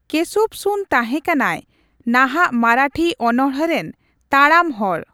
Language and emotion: Santali, neutral